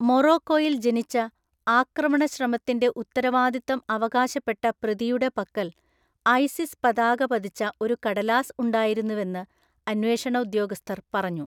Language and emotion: Malayalam, neutral